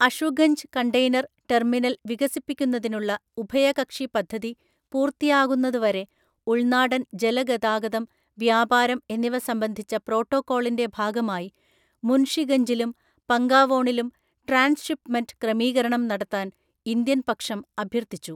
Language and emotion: Malayalam, neutral